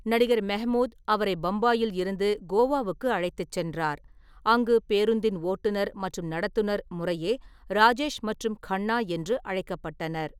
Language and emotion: Tamil, neutral